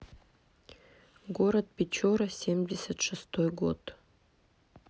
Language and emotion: Russian, neutral